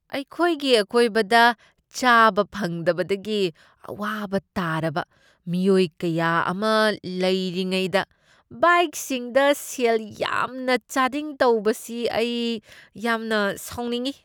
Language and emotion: Manipuri, disgusted